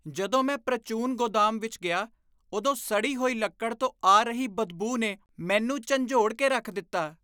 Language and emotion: Punjabi, disgusted